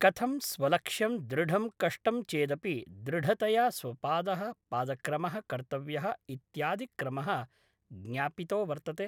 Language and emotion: Sanskrit, neutral